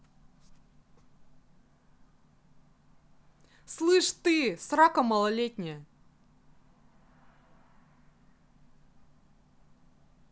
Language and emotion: Russian, angry